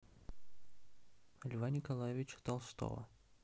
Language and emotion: Russian, neutral